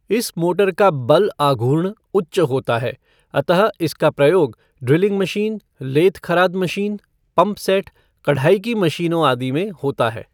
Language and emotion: Hindi, neutral